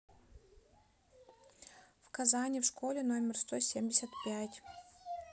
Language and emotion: Russian, neutral